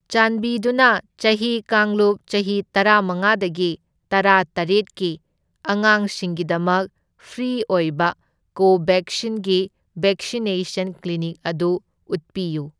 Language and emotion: Manipuri, neutral